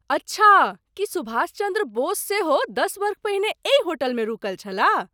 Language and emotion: Maithili, surprised